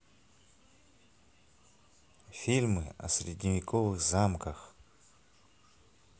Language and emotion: Russian, neutral